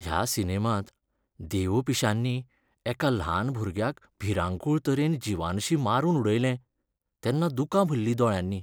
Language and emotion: Goan Konkani, sad